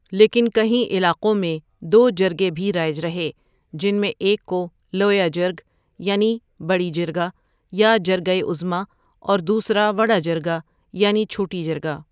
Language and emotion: Urdu, neutral